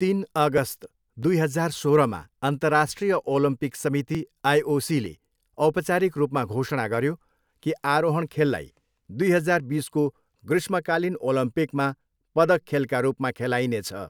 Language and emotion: Nepali, neutral